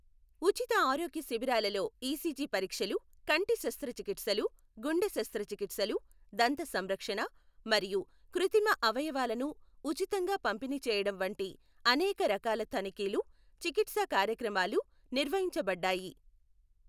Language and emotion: Telugu, neutral